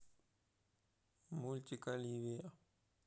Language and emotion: Russian, neutral